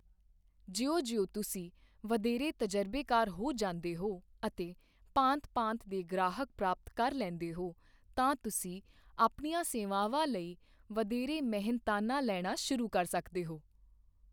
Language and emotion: Punjabi, neutral